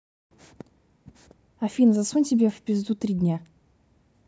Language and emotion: Russian, angry